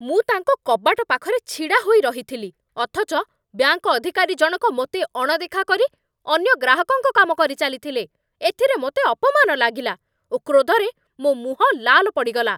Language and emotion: Odia, angry